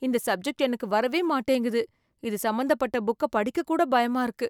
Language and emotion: Tamil, fearful